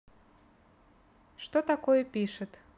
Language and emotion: Russian, neutral